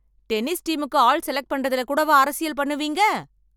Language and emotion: Tamil, angry